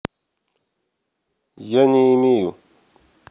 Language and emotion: Russian, neutral